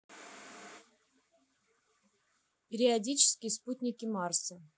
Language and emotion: Russian, neutral